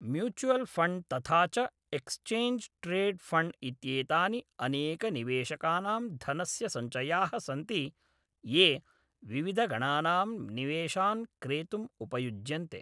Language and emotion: Sanskrit, neutral